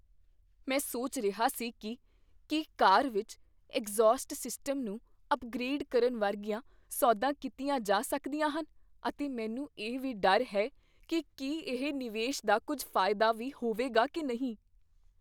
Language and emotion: Punjabi, fearful